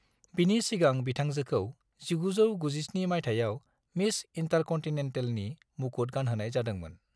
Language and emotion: Bodo, neutral